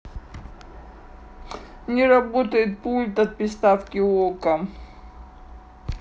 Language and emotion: Russian, sad